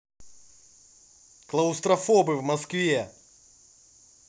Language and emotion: Russian, angry